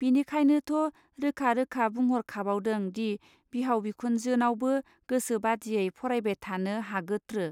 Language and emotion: Bodo, neutral